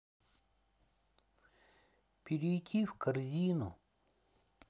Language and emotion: Russian, sad